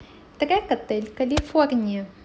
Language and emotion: Russian, positive